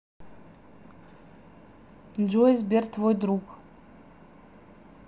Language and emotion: Russian, neutral